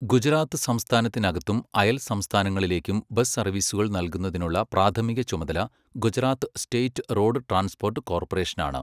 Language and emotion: Malayalam, neutral